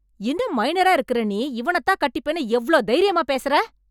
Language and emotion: Tamil, angry